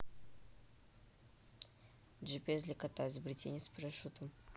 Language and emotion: Russian, neutral